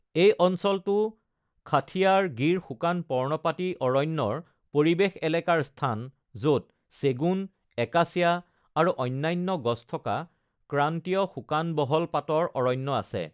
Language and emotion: Assamese, neutral